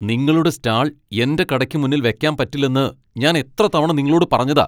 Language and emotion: Malayalam, angry